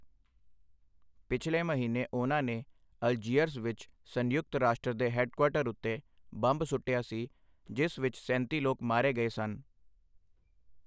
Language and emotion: Punjabi, neutral